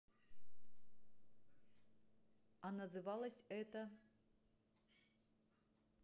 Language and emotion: Russian, neutral